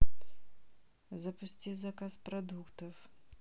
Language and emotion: Russian, neutral